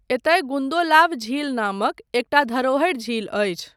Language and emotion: Maithili, neutral